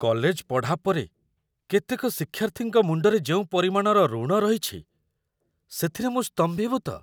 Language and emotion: Odia, surprised